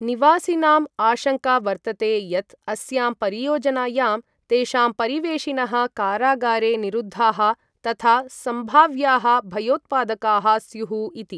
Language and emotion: Sanskrit, neutral